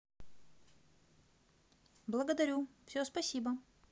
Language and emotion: Russian, positive